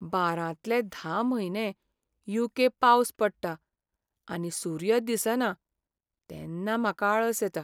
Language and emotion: Goan Konkani, sad